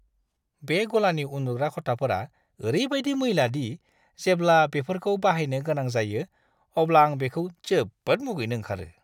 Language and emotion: Bodo, disgusted